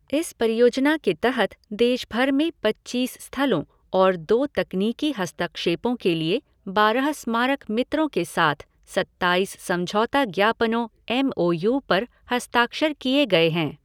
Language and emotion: Hindi, neutral